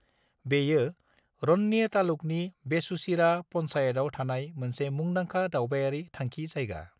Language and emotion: Bodo, neutral